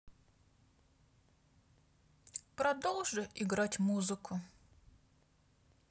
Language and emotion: Russian, sad